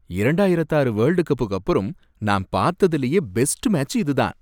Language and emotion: Tamil, happy